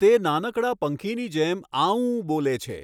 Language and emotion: Gujarati, neutral